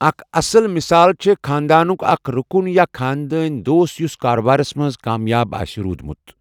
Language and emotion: Kashmiri, neutral